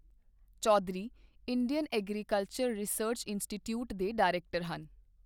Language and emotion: Punjabi, neutral